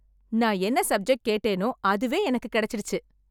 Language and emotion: Tamil, happy